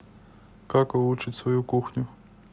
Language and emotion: Russian, neutral